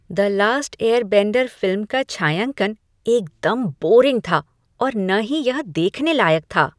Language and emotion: Hindi, disgusted